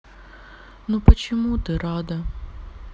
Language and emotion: Russian, sad